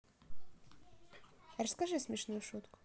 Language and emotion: Russian, neutral